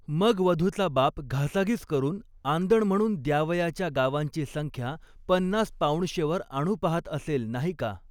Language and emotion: Marathi, neutral